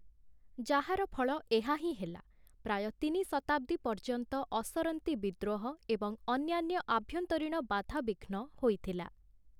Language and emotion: Odia, neutral